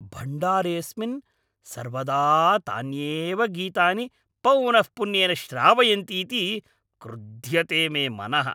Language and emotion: Sanskrit, angry